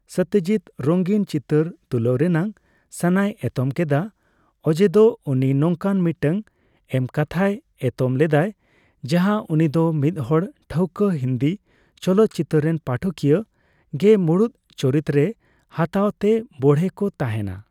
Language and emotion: Santali, neutral